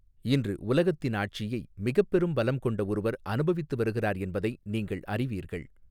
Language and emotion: Tamil, neutral